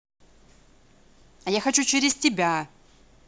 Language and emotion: Russian, angry